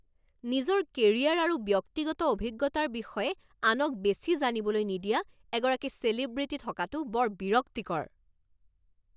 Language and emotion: Assamese, angry